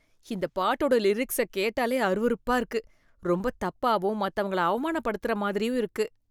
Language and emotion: Tamil, disgusted